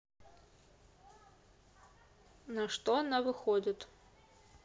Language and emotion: Russian, neutral